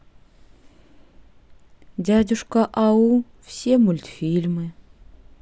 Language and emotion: Russian, sad